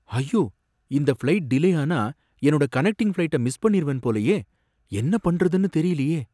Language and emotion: Tamil, fearful